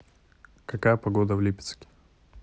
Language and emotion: Russian, neutral